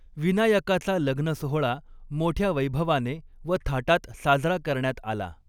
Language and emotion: Marathi, neutral